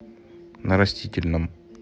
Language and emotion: Russian, neutral